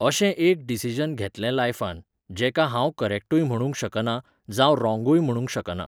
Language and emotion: Goan Konkani, neutral